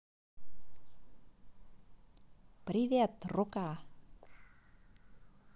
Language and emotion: Russian, positive